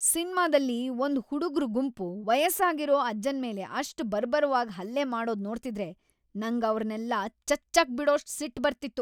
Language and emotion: Kannada, angry